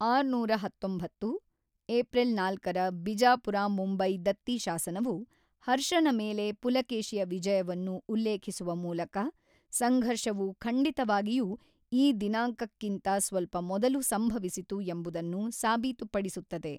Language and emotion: Kannada, neutral